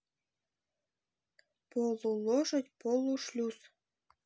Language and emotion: Russian, neutral